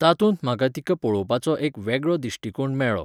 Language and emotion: Goan Konkani, neutral